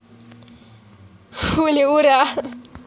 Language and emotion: Russian, positive